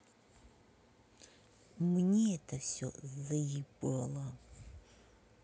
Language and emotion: Russian, angry